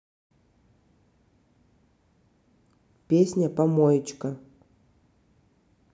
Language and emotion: Russian, neutral